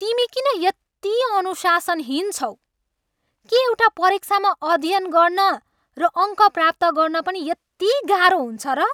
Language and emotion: Nepali, angry